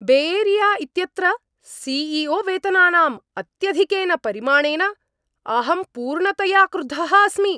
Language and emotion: Sanskrit, angry